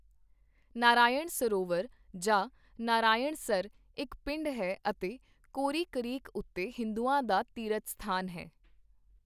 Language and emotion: Punjabi, neutral